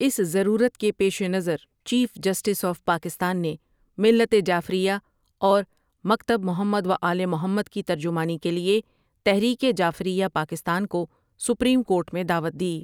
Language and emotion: Urdu, neutral